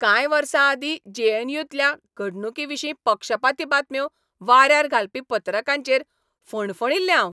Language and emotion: Goan Konkani, angry